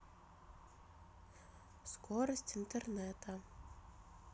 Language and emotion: Russian, neutral